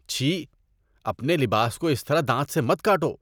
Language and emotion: Urdu, disgusted